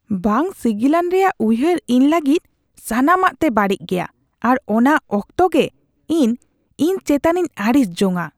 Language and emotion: Santali, disgusted